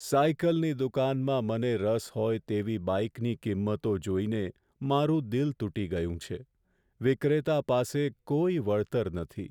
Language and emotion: Gujarati, sad